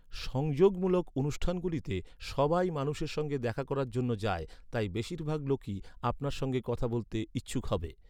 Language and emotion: Bengali, neutral